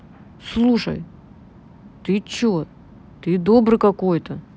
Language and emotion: Russian, neutral